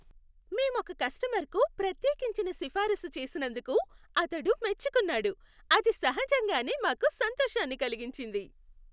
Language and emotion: Telugu, happy